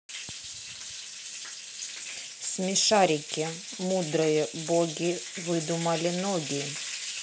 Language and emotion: Russian, neutral